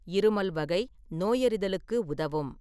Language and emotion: Tamil, neutral